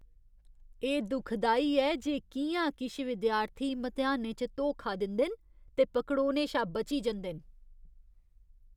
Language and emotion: Dogri, disgusted